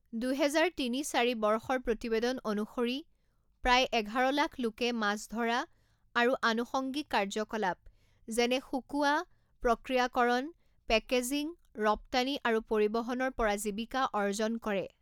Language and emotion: Assamese, neutral